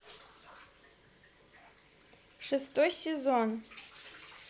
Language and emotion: Russian, neutral